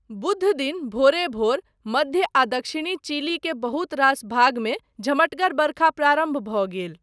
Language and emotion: Maithili, neutral